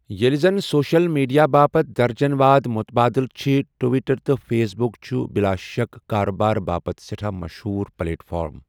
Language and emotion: Kashmiri, neutral